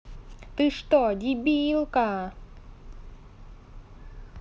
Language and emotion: Russian, angry